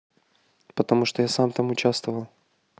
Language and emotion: Russian, neutral